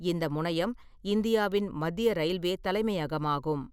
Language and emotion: Tamil, neutral